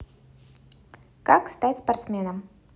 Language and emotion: Russian, neutral